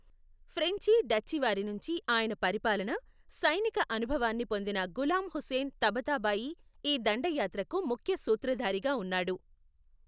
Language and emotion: Telugu, neutral